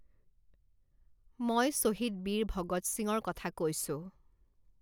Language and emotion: Assamese, neutral